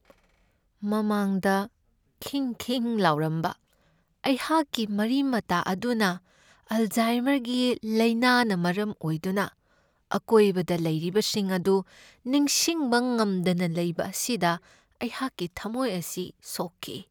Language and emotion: Manipuri, sad